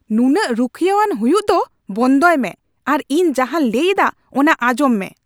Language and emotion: Santali, angry